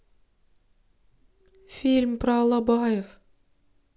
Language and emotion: Russian, sad